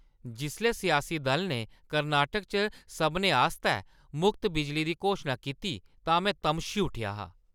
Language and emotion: Dogri, angry